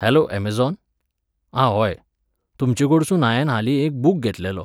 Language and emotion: Goan Konkani, neutral